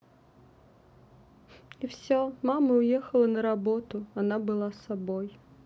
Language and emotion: Russian, sad